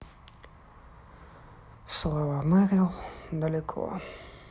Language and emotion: Russian, sad